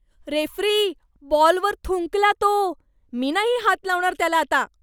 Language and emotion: Marathi, disgusted